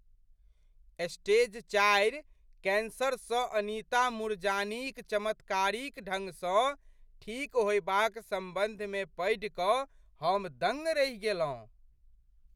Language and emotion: Maithili, surprised